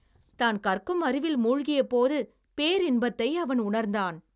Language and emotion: Tamil, happy